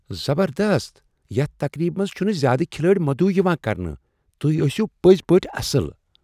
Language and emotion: Kashmiri, surprised